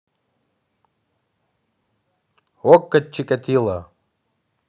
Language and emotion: Russian, neutral